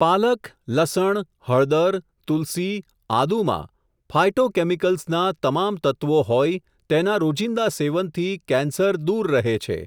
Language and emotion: Gujarati, neutral